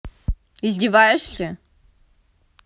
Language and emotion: Russian, angry